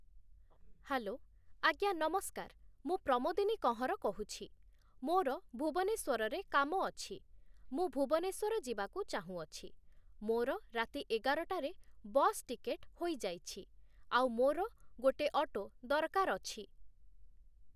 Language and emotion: Odia, neutral